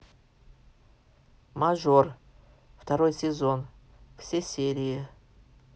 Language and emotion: Russian, neutral